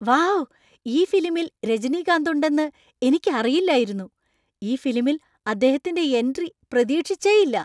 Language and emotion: Malayalam, surprised